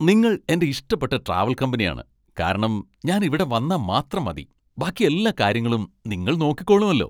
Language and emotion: Malayalam, happy